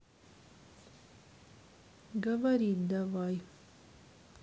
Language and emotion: Russian, sad